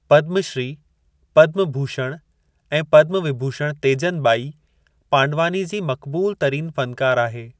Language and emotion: Sindhi, neutral